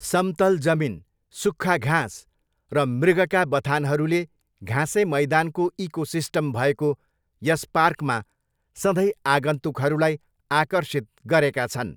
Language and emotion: Nepali, neutral